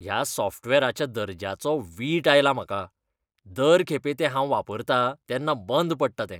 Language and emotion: Goan Konkani, disgusted